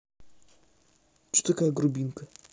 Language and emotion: Russian, neutral